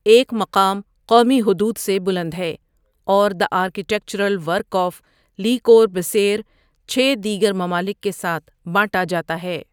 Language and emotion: Urdu, neutral